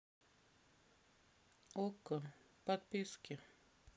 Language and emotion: Russian, sad